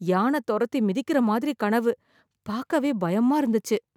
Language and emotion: Tamil, fearful